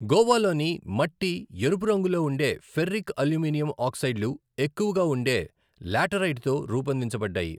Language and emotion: Telugu, neutral